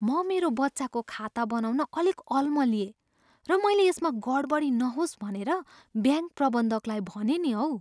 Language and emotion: Nepali, fearful